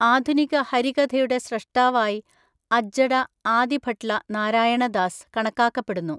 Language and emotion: Malayalam, neutral